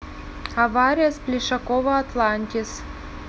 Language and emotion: Russian, neutral